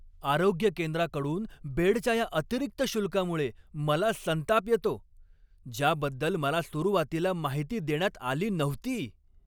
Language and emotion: Marathi, angry